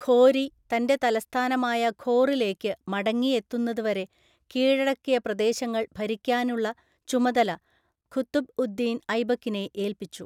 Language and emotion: Malayalam, neutral